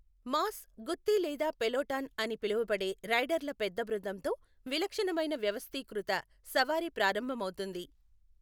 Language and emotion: Telugu, neutral